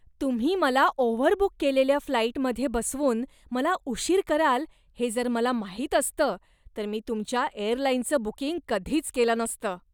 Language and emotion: Marathi, disgusted